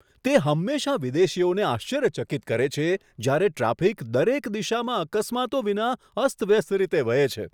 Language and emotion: Gujarati, surprised